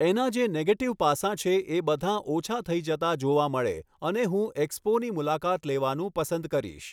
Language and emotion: Gujarati, neutral